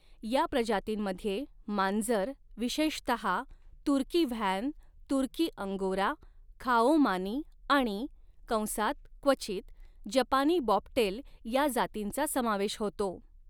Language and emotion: Marathi, neutral